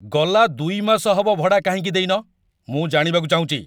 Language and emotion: Odia, angry